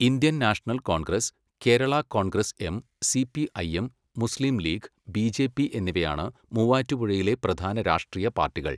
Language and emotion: Malayalam, neutral